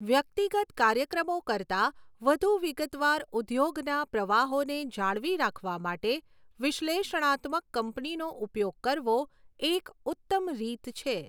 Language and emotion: Gujarati, neutral